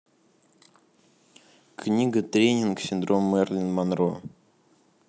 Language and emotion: Russian, neutral